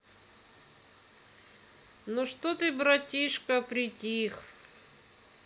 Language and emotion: Russian, neutral